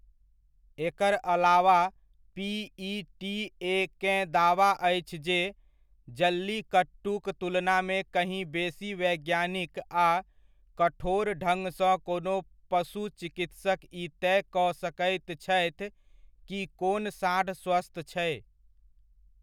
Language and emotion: Maithili, neutral